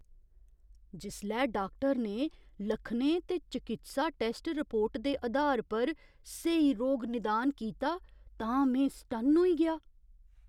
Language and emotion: Dogri, surprised